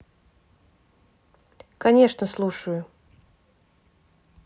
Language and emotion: Russian, neutral